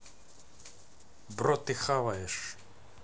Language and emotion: Russian, neutral